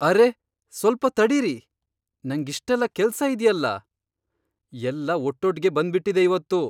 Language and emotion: Kannada, surprised